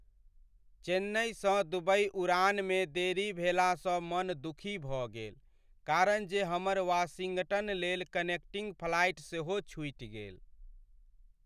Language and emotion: Maithili, sad